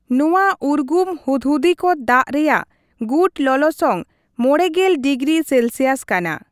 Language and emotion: Santali, neutral